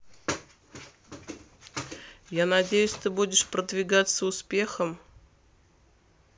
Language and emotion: Russian, neutral